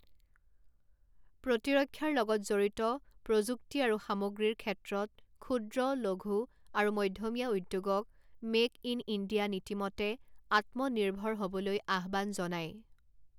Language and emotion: Assamese, neutral